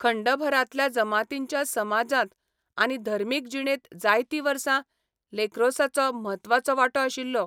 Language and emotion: Goan Konkani, neutral